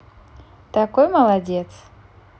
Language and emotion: Russian, positive